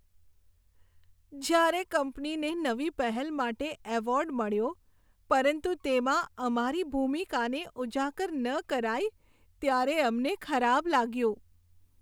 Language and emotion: Gujarati, sad